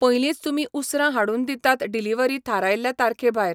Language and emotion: Goan Konkani, neutral